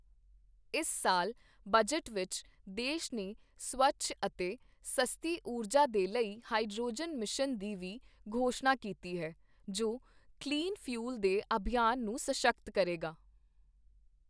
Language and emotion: Punjabi, neutral